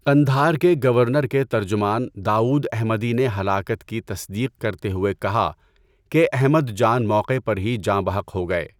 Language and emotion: Urdu, neutral